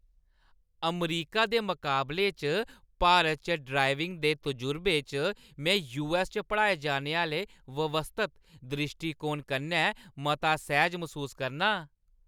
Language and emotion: Dogri, happy